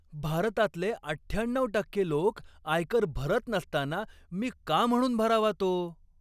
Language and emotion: Marathi, angry